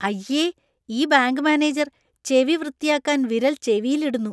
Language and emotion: Malayalam, disgusted